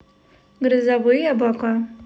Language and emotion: Russian, neutral